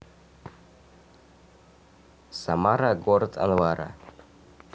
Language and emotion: Russian, neutral